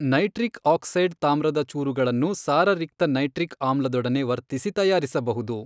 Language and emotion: Kannada, neutral